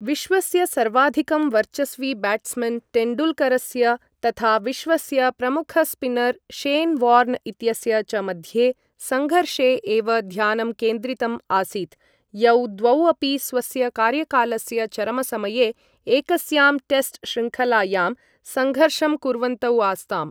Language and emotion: Sanskrit, neutral